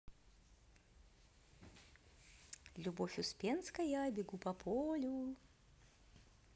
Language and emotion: Russian, positive